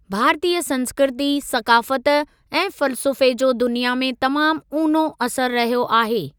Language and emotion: Sindhi, neutral